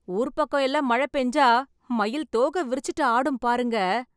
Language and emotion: Tamil, happy